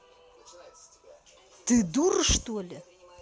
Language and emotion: Russian, angry